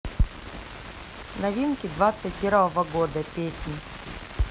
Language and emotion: Russian, neutral